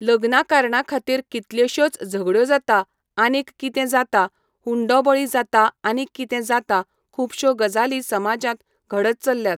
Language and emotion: Goan Konkani, neutral